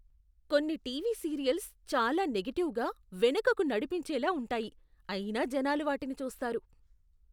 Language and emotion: Telugu, disgusted